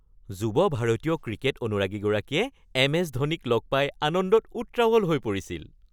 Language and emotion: Assamese, happy